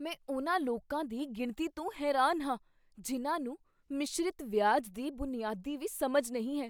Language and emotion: Punjabi, surprised